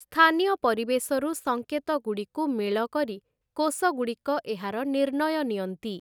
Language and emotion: Odia, neutral